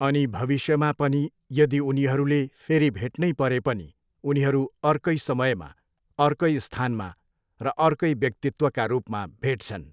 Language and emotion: Nepali, neutral